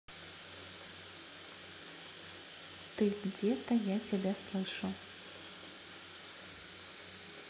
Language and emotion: Russian, neutral